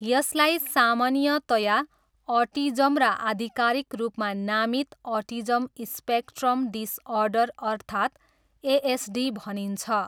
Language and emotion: Nepali, neutral